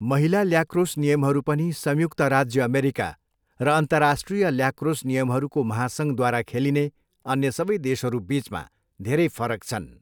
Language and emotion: Nepali, neutral